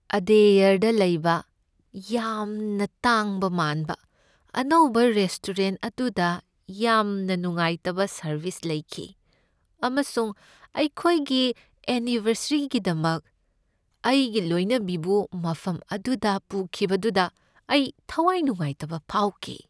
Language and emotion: Manipuri, sad